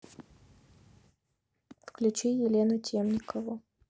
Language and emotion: Russian, neutral